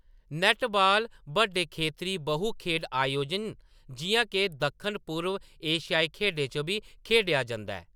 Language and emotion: Dogri, neutral